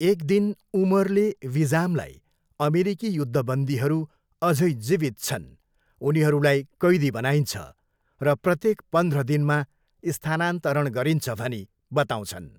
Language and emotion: Nepali, neutral